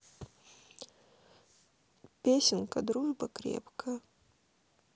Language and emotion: Russian, sad